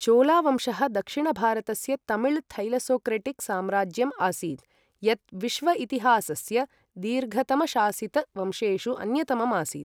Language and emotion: Sanskrit, neutral